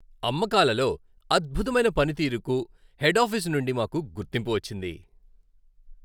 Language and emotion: Telugu, happy